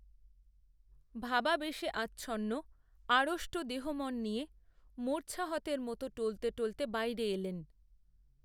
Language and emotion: Bengali, neutral